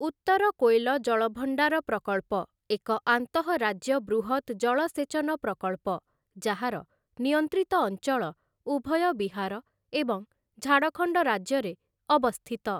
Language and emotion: Odia, neutral